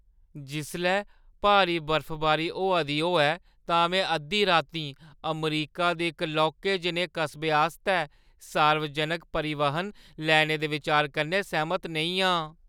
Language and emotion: Dogri, fearful